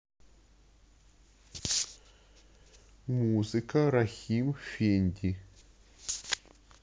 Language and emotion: Russian, neutral